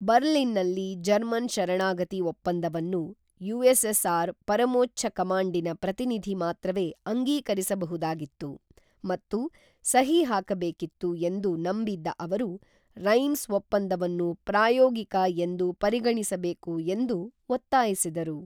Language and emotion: Kannada, neutral